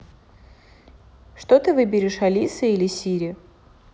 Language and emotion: Russian, neutral